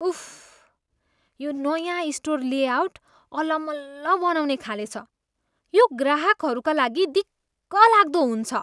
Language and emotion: Nepali, disgusted